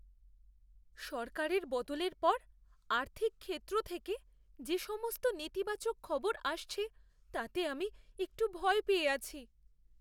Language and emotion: Bengali, fearful